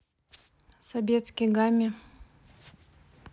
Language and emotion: Russian, neutral